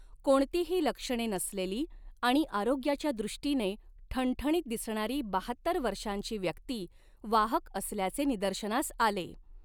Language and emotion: Marathi, neutral